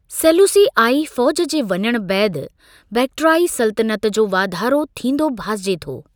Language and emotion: Sindhi, neutral